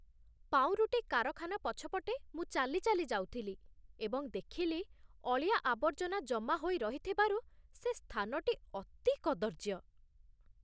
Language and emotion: Odia, disgusted